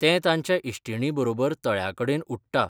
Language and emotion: Goan Konkani, neutral